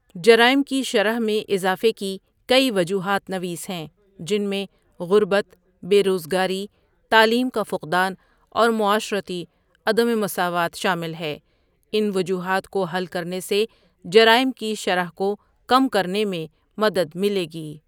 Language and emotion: Urdu, neutral